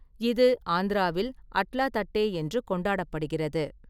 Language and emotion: Tamil, neutral